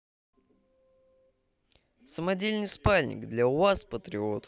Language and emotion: Russian, positive